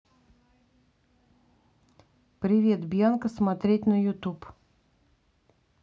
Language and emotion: Russian, neutral